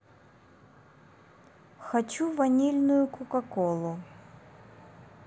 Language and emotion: Russian, neutral